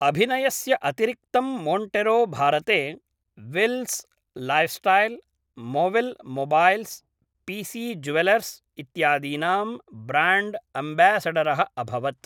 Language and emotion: Sanskrit, neutral